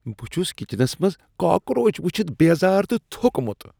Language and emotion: Kashmiri, disgusted